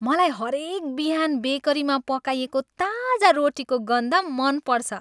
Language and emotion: Nepali, happy